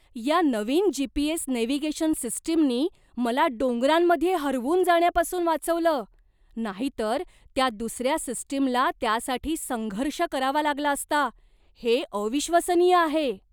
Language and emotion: Marathi, surprised